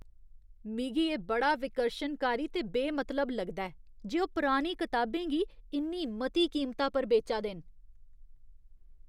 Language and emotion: Dogri, disgusted